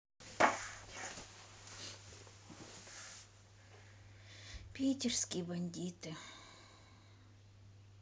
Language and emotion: Russian, sad